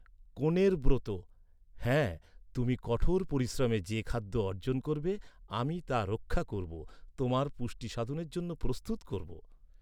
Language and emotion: Bengali, neutral